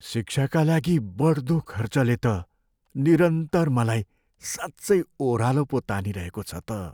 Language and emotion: Nepali, sad